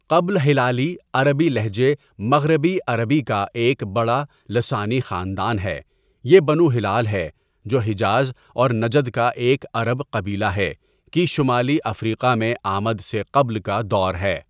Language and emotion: Urdu, neutral